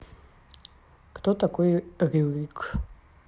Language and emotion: Russian, neutral